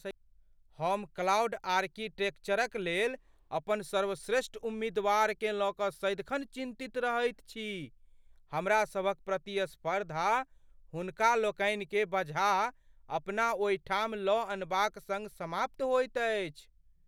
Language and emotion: Maithili, fearful